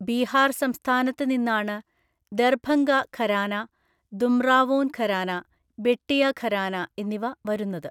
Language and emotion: Malayalam, neutral